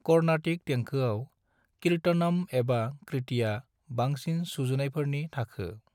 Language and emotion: Bodo, neutral